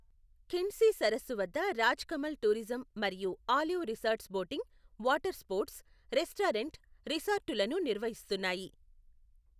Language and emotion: Telugu, neutral